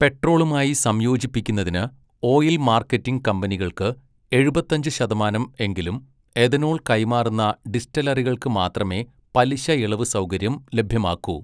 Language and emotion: Malayalam, neutral